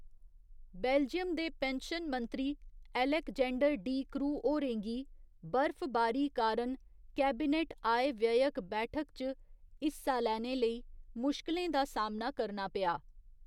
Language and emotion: Dogri, neutral